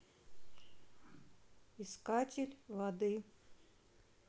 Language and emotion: Russian, neutral